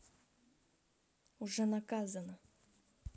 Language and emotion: Russian, neutral